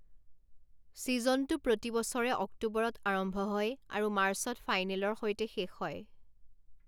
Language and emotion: Assamese, neutral